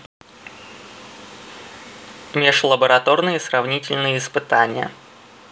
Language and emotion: Russian, neutral